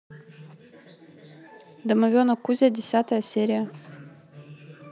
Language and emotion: Russian, neutral